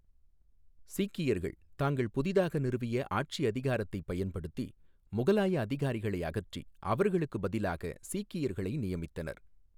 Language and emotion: Tamil, neutral